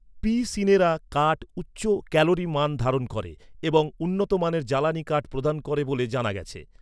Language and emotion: Bengali, neutral